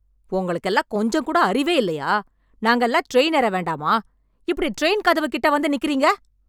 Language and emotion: Tamil, angry